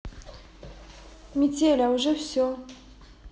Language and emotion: Russian, neutral